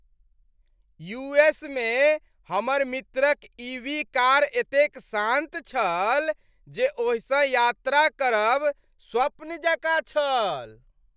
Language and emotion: Maithili, happy